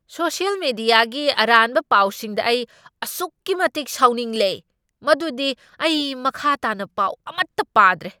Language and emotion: Manipuri, angry